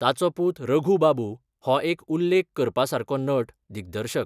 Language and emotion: Goan Konkani, neutral